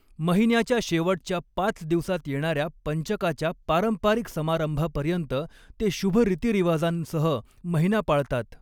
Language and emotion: Marathi, neutral